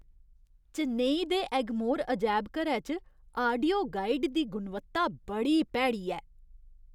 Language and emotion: Dogri, disgusted